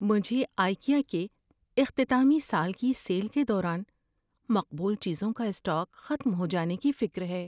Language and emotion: Urdu, fearful